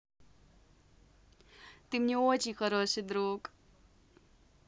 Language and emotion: Russian, positive